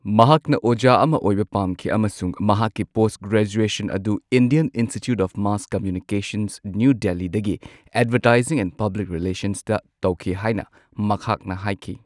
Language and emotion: Manipuri, neutral